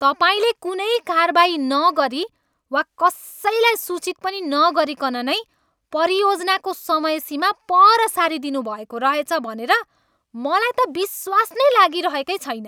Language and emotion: Nepali, angry